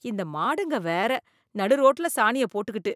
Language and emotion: Tamil, disgusted